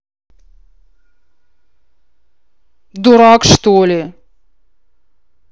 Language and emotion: Russian, angry